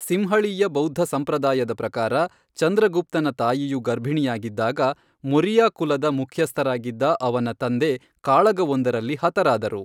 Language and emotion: Kannada, neutral